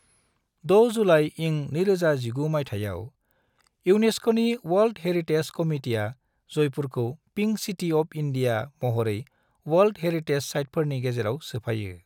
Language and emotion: Bodo, neutral